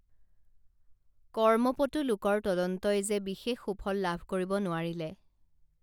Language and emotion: Assamese, neutral